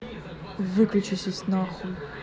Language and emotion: Russian, angry